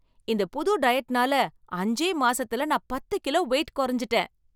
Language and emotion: Tamil, happy